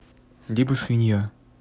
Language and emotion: Russian, neutral